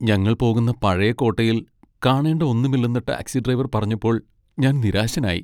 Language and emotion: Malayalam, sad